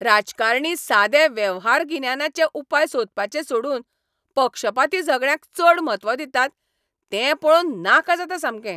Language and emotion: Goan Konkani, angry